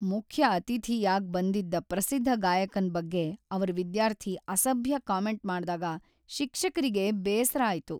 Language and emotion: Kannada, sad